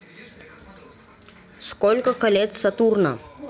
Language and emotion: Russian, neutral